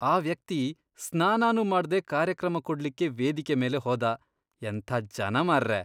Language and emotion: Kannada, disgusted